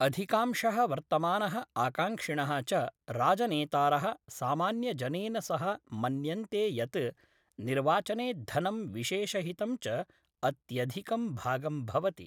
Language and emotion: Sanskrit, neutral